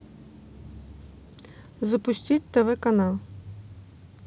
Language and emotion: Russian, neutral